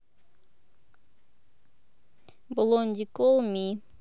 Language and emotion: Russian, neutral